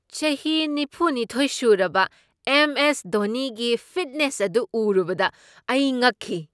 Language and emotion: Manipuri, surprised